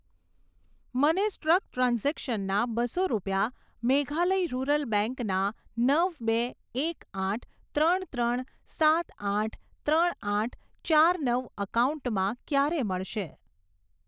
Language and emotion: Gujarati, neutral